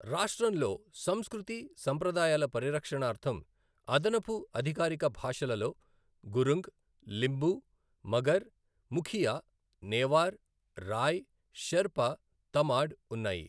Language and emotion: Telugu, neutral